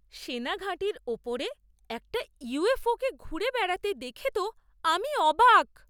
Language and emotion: Bengali, surprised